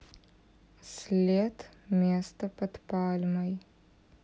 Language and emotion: Russian, sad